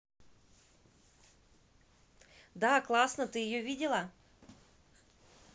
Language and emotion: Russian, positive